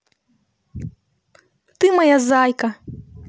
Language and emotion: Russian, positive